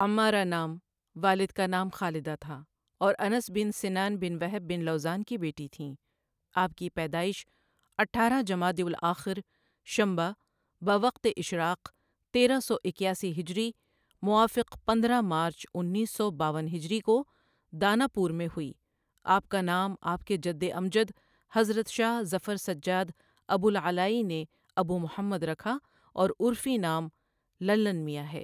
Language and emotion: Urdu, neutral